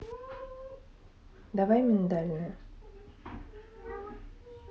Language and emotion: Russian, neutral